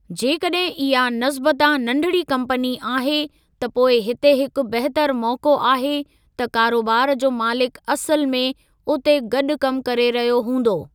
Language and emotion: Sindhi, neutral